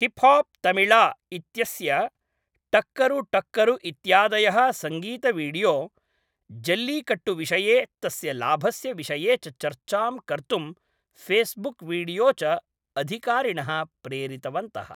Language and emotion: Sanskrit, neutral